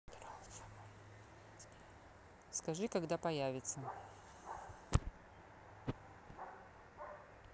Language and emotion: Russian, neutral